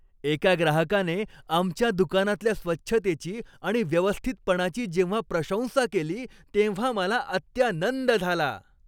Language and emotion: Marathi, happy